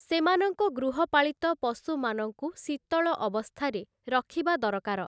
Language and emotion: Odia, neutral